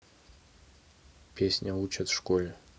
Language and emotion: Russian, neutral